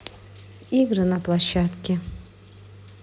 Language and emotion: Russian, neutral